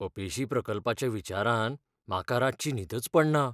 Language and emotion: Goan Konkani, fearful